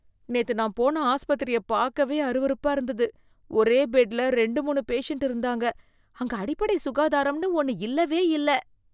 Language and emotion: Tamil, disgusted